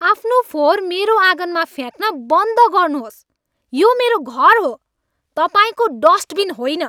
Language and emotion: Nepali, angry